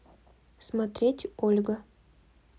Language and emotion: Russian, neutral